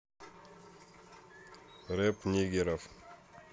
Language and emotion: Russian, neutral